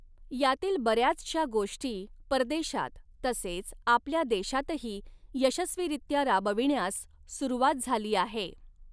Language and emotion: Marathi, neutral